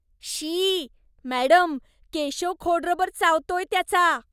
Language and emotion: Marathi, disgusted